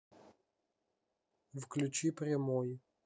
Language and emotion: Russian, neutral